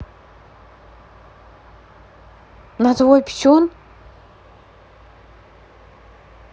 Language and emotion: Russian, neutral